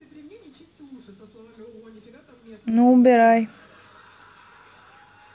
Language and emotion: Russian, neutral